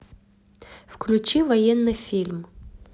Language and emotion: Russian, neutral